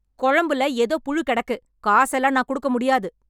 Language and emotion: Tamil, angry